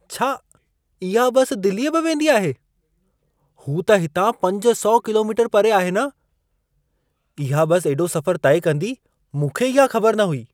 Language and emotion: Sindhi, surprised